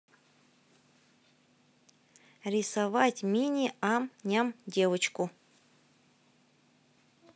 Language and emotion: Russian, neutral